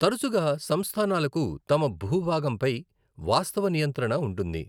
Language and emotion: Telugu, neutral